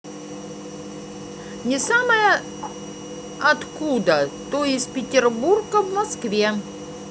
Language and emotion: Russian, neutral